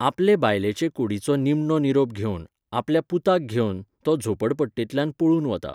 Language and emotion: Goan Konkani, neutral